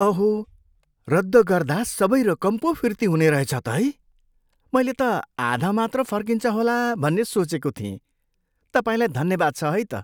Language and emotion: Nepali, surprised